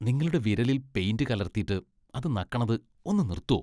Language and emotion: Malayalam, disgusted